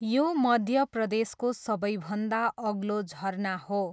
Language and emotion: Nepali, neutral